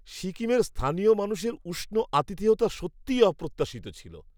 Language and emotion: Bengali, surprised